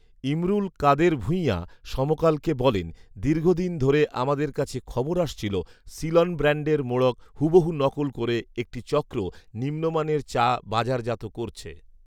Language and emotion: Bengali, neutral